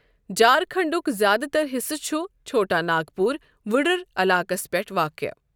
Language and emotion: Kashmiri, neutral